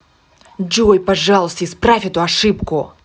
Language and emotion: Russian, angry